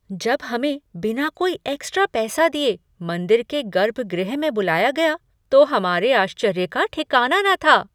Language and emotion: Hindi, surprised